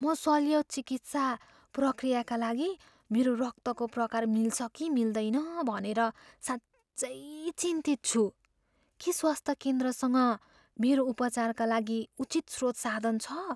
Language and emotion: Nepali, fearful